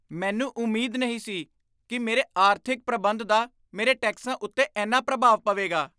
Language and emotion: Punjabi, surprised